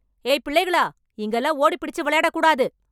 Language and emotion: Tamil, angry